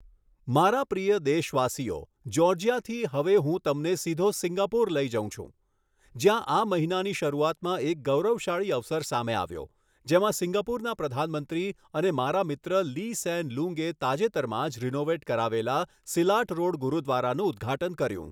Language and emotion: Gujarati, neutral